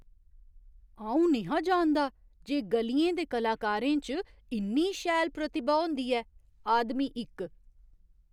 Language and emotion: Dogri, surprised